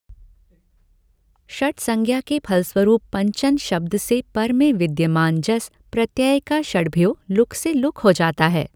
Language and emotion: Hindi, neutral